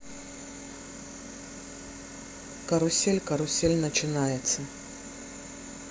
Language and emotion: Russian, neutral